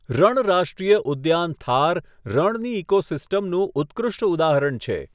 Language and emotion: Gujarati, neutral